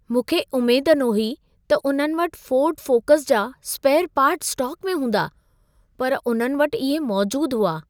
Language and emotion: Sindhi, surprised